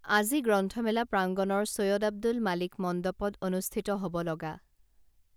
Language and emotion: Assamese, neutral